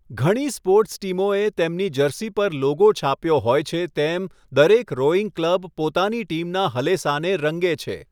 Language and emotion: Gujarati, neutral